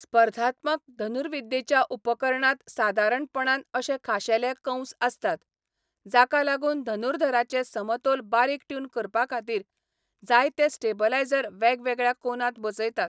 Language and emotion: Goan Konkani, neutral